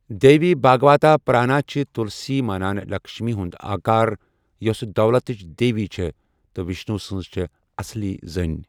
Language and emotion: Kashmiri, neutral